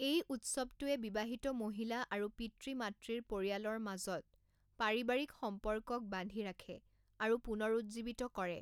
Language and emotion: Assamese, neutral